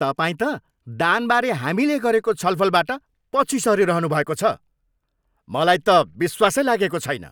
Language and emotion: Nepali, angry